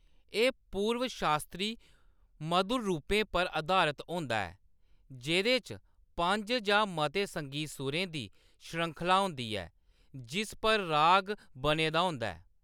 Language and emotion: Dogri, neutral